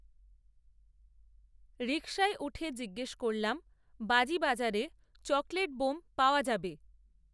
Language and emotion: Bengali, neutral